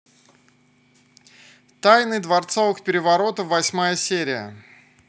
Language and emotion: Russian, neutral